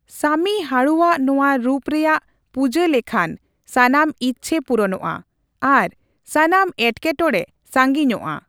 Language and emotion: Santali, neutral